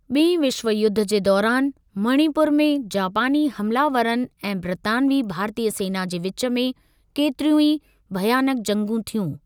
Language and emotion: Sindhi, neutral